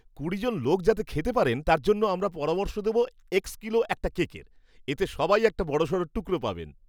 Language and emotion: Bengali, happy